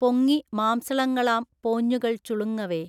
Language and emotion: Malayalam, neutral